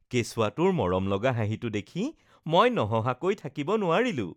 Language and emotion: Assamese, happy